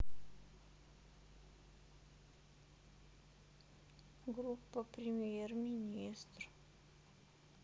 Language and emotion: Russian, sad